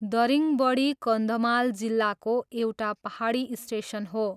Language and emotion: Nepali, neutral